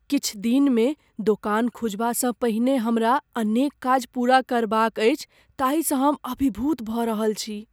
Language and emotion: Maithili, fearful